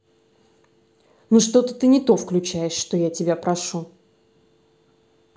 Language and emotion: Russian, angry